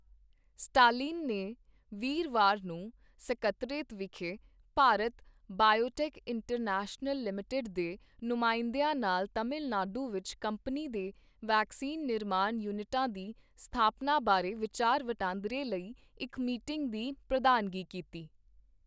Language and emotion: Punjabi, neutral